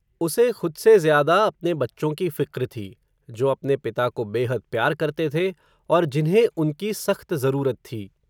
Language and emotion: Hindi, neutral